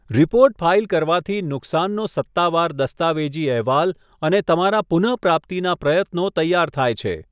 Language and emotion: Gujarati, neutral